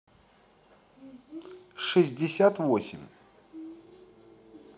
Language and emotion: Russian, neutral